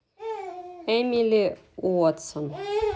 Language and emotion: Russian, neutral